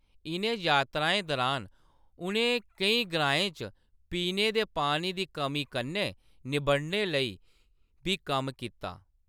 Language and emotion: Dogri, neutral